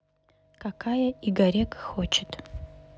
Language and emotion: Russian, neutral